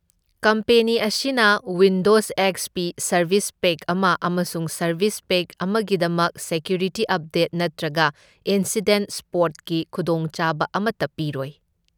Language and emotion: Manipuri, neutral